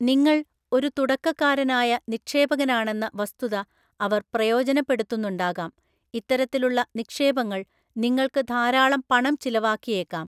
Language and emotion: Malayalam, neutral